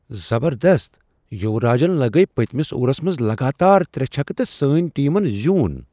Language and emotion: Kashmiri, surprised